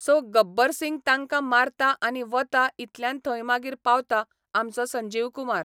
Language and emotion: Goan Konkani, neutral